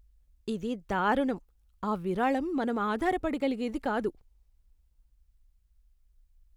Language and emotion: Telugu, disgusted